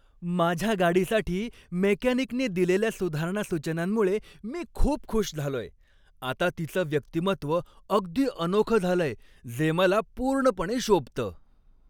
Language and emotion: Marathi, happy